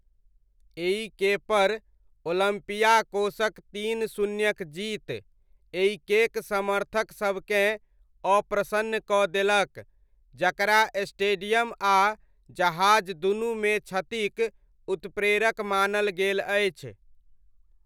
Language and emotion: Maithili, neutral